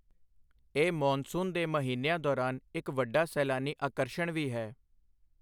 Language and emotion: Punjabi, neutral